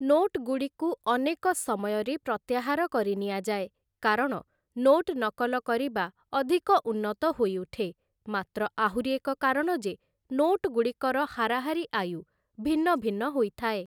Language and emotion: Odia, neutral